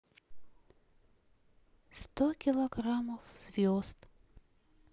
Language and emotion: Russian, sad